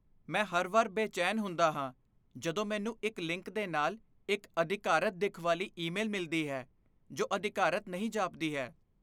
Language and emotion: Punjabi, fearful